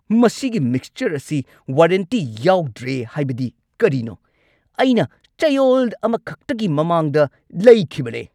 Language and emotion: Manipuri, angry